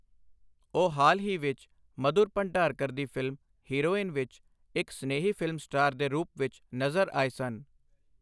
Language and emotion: Punjabi, neutral